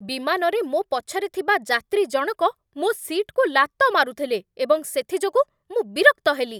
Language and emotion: Odia, angry